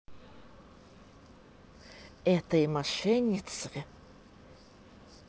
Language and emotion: Russian, angry